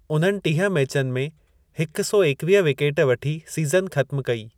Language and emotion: Sindhi, neutral